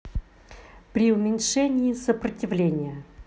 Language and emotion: Russian, neutral